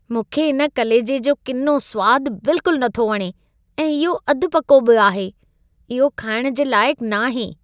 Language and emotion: Sindhi, disgusted